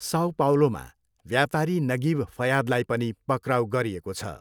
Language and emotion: Nepali, neutral